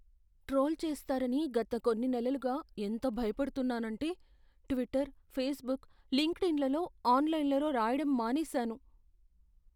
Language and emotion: Telugu, fearful